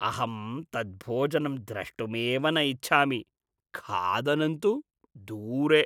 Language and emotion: Sanskrit, disgusted